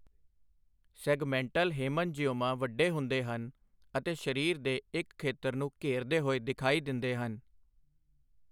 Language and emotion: Punjabi, neutral